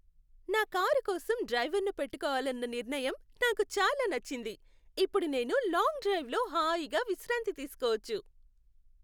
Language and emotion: Telugu, happy